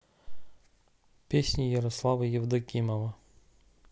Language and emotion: Russian, neutral